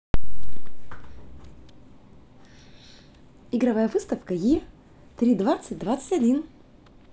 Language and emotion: Russian, positive